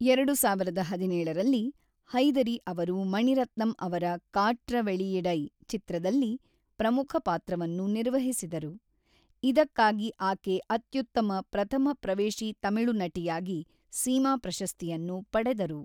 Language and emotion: Kannada, neutral